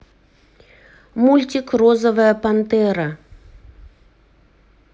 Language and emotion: Russian, neutral